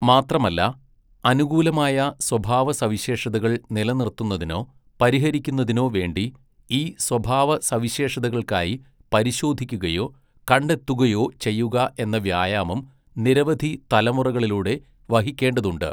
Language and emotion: Malayalam, neutral